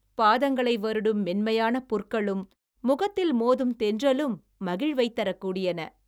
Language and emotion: Tamil, happy